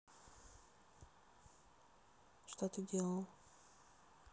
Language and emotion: Russian, neutral